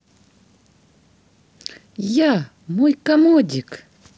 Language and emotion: Russian, positive